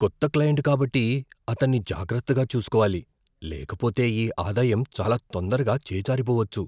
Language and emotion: Telugu, fearful